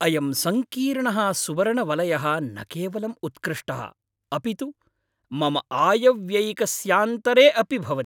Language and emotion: Sanskrit, happy